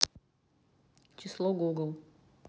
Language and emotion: Russian, neutral